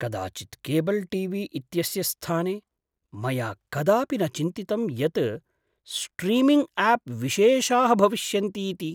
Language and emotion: Sanskrit, surprised